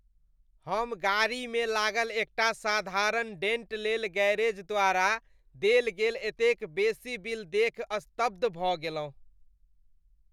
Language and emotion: Maithili, disgusted